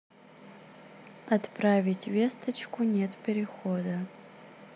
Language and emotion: Russian, neutral